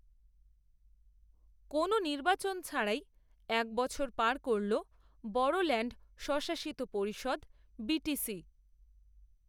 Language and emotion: Bengali, neutral